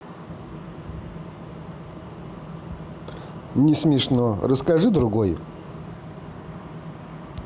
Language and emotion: Russian, neutral